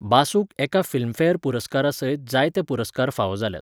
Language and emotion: Goan Konkani, neutral